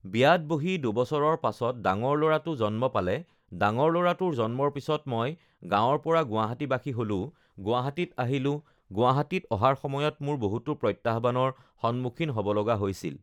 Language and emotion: Assamese, neutral